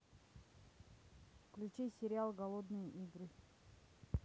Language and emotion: Russian, neutral